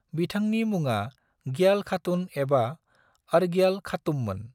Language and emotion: Bodo, neutral